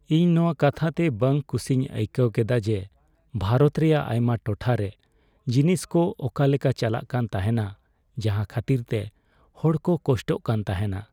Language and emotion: Santali, sad